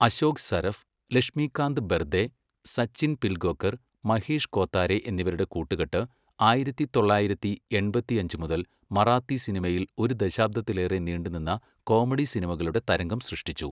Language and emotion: Malayalam, neutral